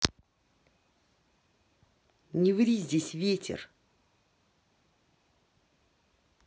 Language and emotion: Russian, angry